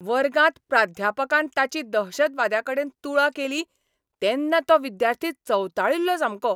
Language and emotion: Goan Konkani, angry